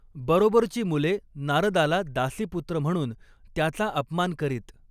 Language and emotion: Marathi, neutral